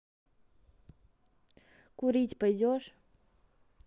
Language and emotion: Russian, neutral